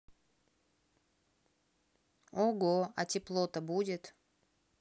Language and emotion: Russian, neutral